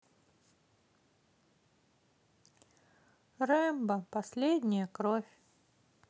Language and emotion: Russian, sad